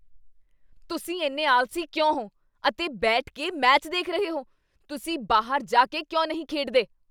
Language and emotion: Punjabi, angry